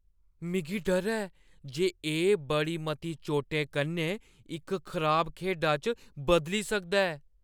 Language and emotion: Dogri, fearful